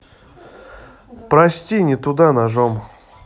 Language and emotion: Russian, sad